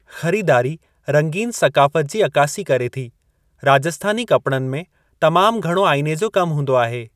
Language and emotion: Sindhi, neutral